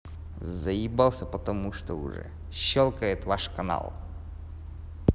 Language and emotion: Russian, angry